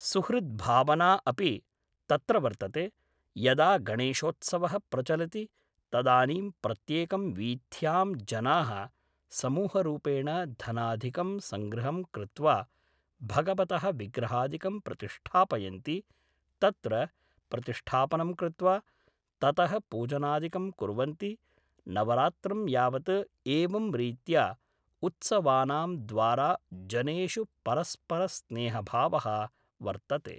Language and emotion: Sanskrit, neutral